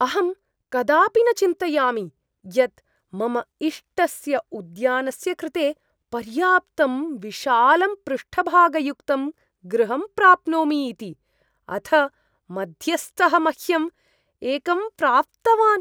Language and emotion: Sanskrit, surprised